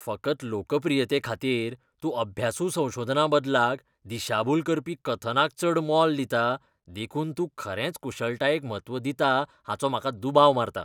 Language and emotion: Goan Konkani, disgusted